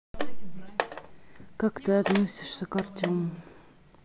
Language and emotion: Russian, neutral